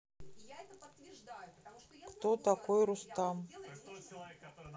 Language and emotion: Russian, neutral